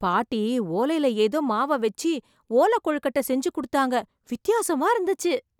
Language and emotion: Tamil, surprised